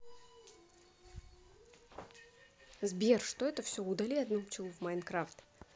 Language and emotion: Russian, neutral